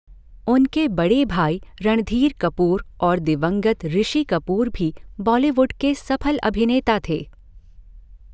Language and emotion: Hindi, neutral